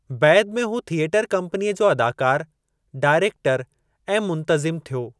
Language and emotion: Sindhi, neutral